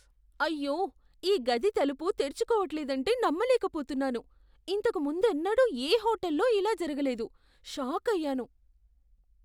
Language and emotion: Telugu, surprised